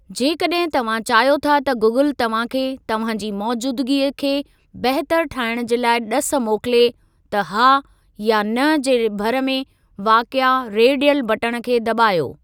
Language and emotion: Sindhi, neutral